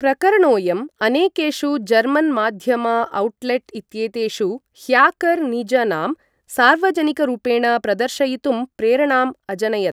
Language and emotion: Sanskrit, neutral